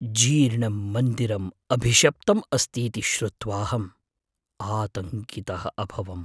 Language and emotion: Sanskrit, fearful